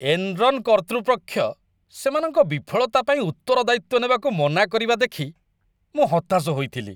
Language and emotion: Odia, disgusted